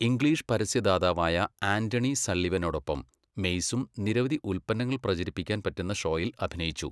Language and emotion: Malayalam, neutral